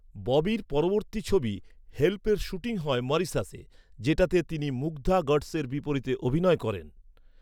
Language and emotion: Bengali, neutral